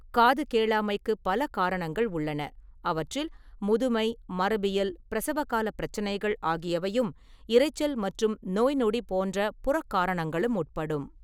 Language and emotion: Tamil, neutral